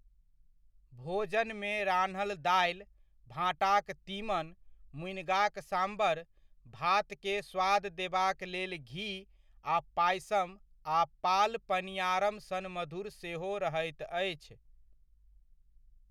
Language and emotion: Maithili, neutral